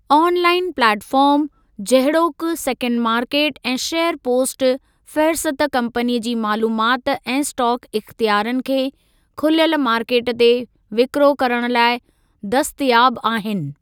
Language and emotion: Sindhi, neutral